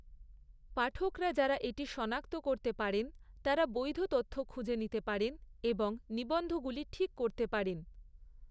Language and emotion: Bengali, neutral